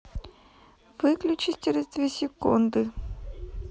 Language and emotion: Russian, neutral